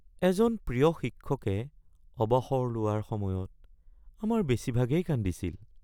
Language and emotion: Assamese, sad